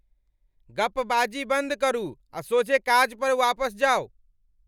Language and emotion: Maithili, angry